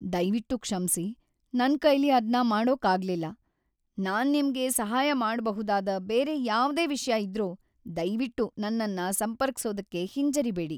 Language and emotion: Kannada, sad